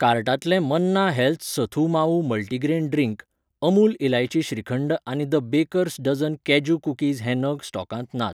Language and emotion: Goan Konkani, neutral